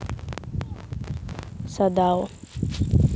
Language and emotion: Russian, neutral